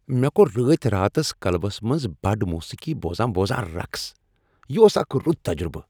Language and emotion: Kashmiri, happy